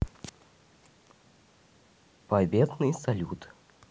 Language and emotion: Russian, neutral